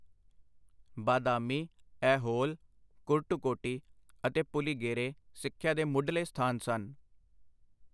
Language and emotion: Punjabi, neutral